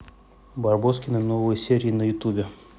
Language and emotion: Russian, neutral